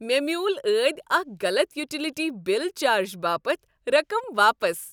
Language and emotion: Kashmiri, happy